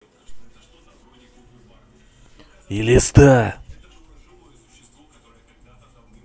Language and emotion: Russian, angry